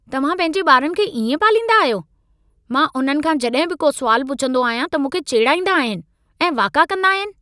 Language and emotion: Sindhi, angry